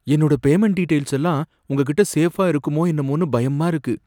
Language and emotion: Tamil, fearful